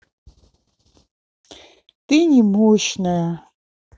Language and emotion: Russian, neutral